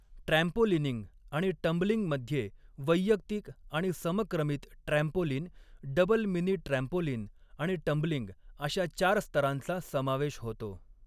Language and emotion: Marathi, neutral